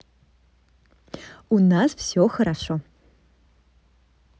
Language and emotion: Russian, positive